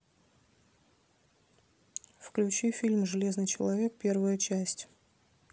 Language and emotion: Russian, neutral